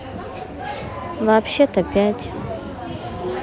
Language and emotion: Russian, neutral